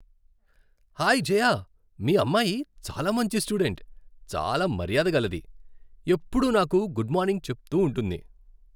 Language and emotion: Telugu, happy